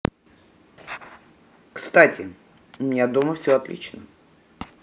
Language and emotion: Russian, neutral